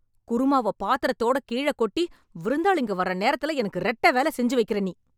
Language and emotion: Tamil, angry